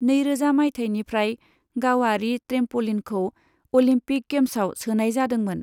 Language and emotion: Bodo, neutral